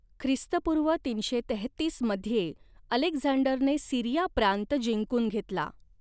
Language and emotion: Marathi, neutral